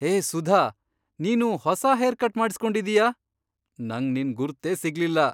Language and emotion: Kannada, surprised